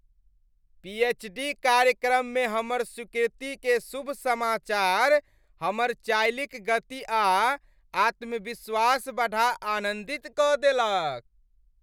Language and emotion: Maithili, happy